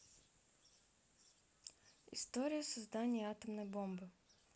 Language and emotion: Russian, neutral